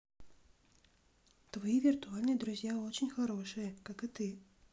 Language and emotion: Russian, neutral